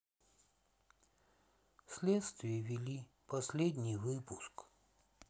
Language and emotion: Russian, sad